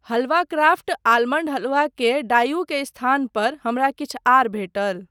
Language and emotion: Maithili, neutral